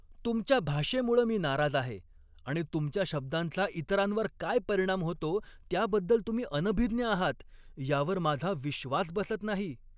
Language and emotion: Marathi, angry